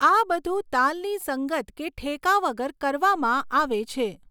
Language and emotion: Gujarati, neutral